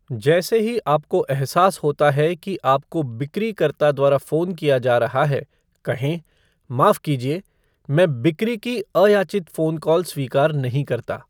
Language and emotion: Hindi, neutral